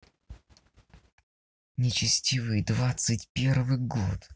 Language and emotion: Russian, angry